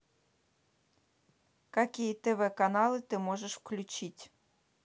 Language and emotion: Russian, neutral